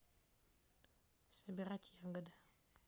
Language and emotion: Russian, neutral